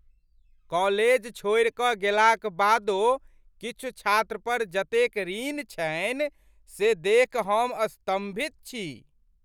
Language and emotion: Maithili, surprised